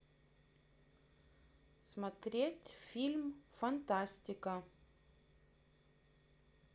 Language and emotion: Russian, neutral